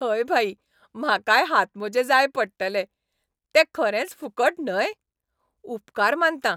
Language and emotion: Goan Konkani, happy